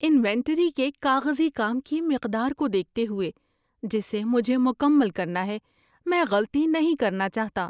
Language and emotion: Urdu, fearful